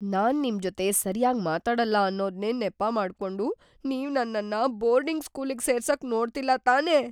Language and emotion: Kannada, fearful